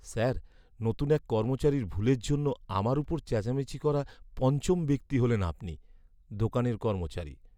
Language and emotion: Bengali, sad